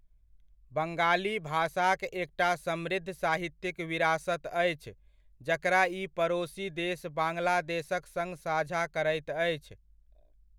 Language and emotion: Maithili, neutral